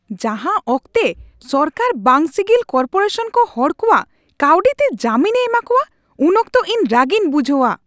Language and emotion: Santali, angry